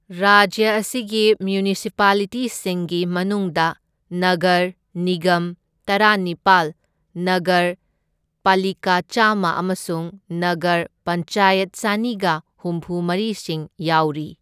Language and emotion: Manipuri, neutral